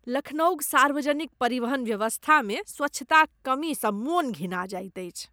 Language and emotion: Maithili, disgusted